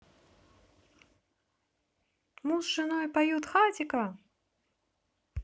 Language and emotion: Russian, positive